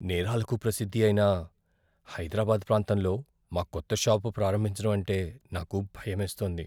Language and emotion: Telugu, fearful